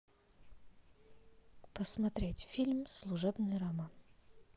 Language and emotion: Russian, neutral